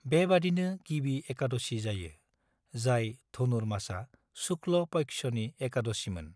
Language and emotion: Bodo, neutral